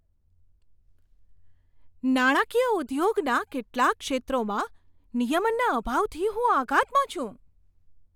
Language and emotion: Gujarati, surprised